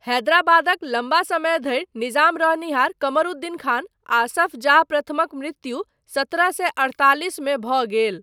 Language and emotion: Maithili, neutral